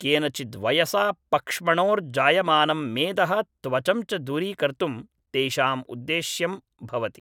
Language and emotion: Sanskrit, neutral